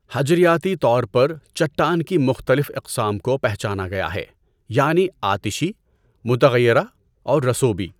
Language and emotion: Urdu, neutral